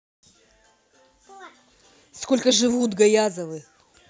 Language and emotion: Russian, angry